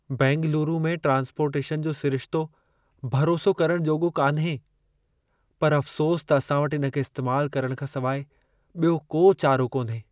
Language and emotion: Sindhi, sad